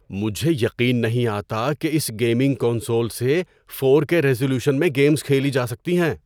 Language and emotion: Urdu, surprised